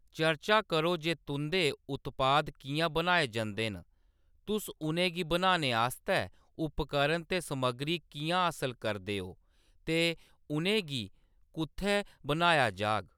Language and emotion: Dogri, neutral